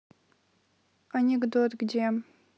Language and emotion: Russian, neutral